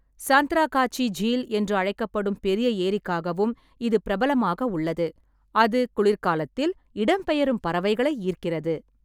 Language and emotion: Tamil, neutral